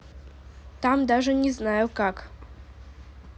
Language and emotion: Russian, neutral